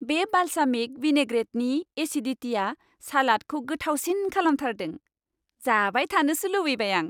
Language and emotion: Bodo, happy